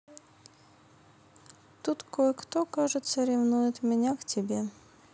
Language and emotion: Russian, neutral